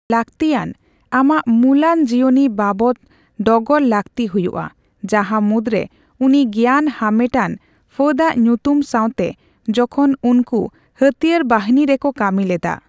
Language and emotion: Santali, neutral